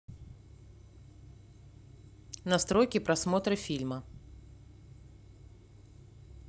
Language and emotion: Russian, neutral